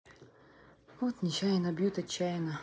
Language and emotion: Russian, sad